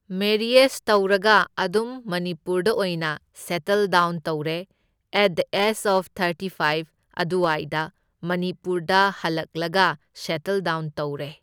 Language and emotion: Manipuri, neutral